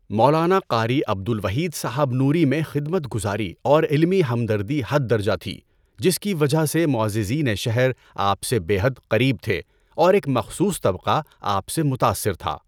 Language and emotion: Urdu, neutral